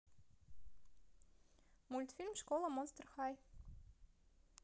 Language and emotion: Russian, positive